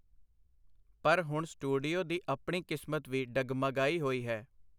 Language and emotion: Punjabi, neutral